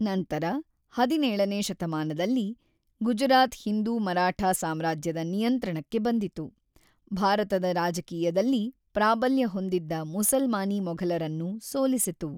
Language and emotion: Kannada, neutral